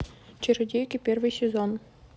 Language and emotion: Russian, neutral